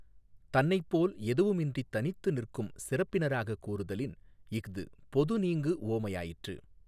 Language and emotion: Tamil, neutral